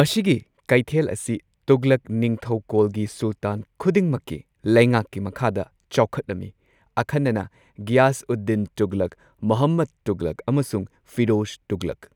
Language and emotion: Manipuri, neutral